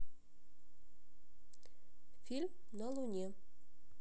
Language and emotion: Russian, neutral